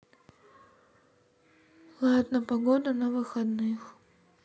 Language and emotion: Russian, sad